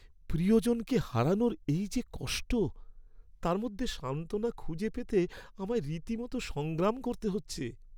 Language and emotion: Bengali, sad